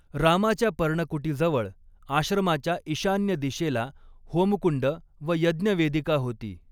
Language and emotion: Marathi, neutral